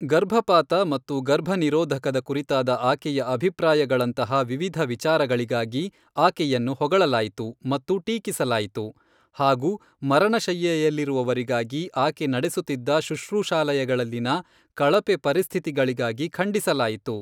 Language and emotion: Kannada, neutral